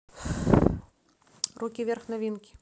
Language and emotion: Russian, neutral